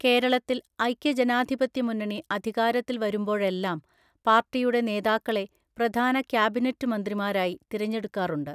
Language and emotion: Malayalam, neutral